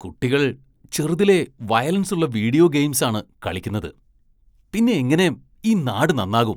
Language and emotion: Malayalam, disgusted